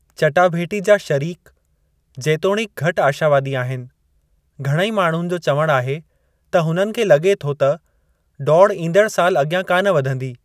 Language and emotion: Sindhi, neutral